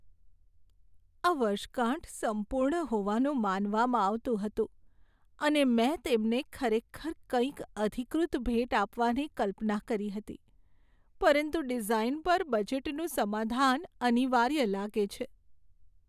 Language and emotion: Gujarati, sad